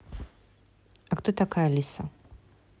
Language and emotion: Russian, neutral